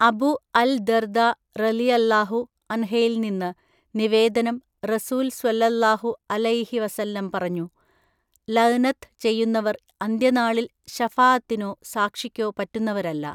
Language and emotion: Malayalam, neutral